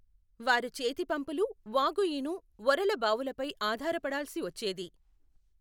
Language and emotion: Telugu, neutral